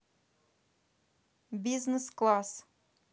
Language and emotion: Russian, neutral